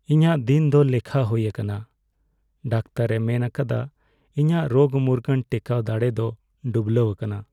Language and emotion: Santali, sad